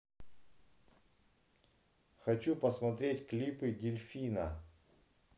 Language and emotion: Russian, neutral